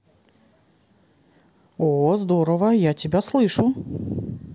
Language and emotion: Russian, positive